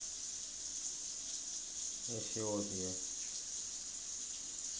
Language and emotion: Russian, neutral